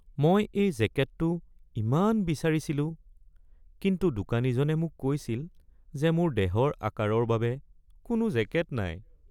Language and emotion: Assamese, sad